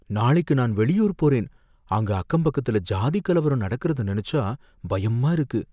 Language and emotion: Tamil, fearful